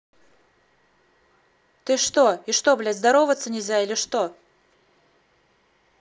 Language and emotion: Russian, angry